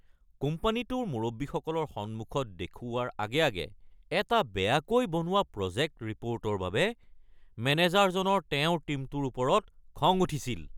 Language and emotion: Assamese, angry